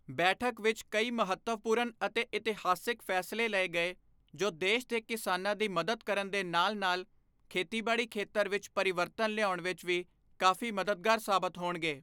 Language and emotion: Punjabi, neutral